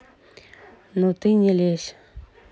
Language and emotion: Russian, neutral